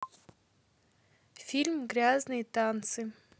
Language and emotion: Russian, neutral